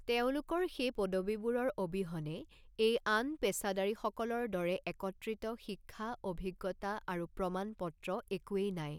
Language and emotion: Assamese, neutral